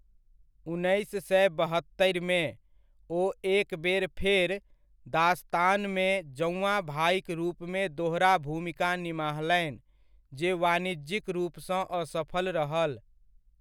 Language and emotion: Maithili, neutral